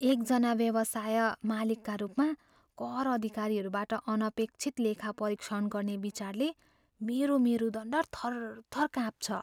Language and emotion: Nepali, fearful